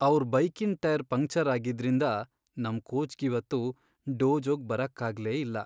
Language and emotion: Kannada, sad